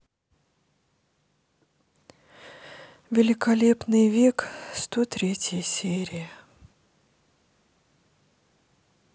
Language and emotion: Russian, sad